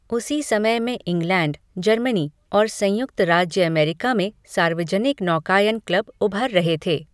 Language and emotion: Hindi, neutral